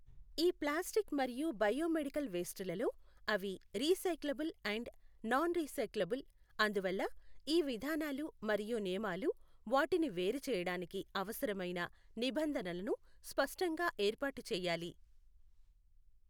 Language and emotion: Telugu, neutral